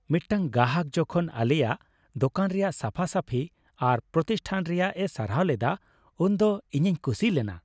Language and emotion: Santali, happy